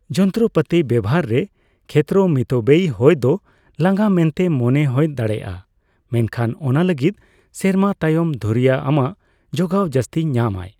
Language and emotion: Santali, neutral